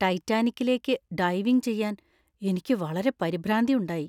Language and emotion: Malayalam, fearful